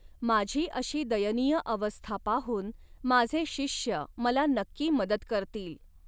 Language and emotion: Marathi, neutral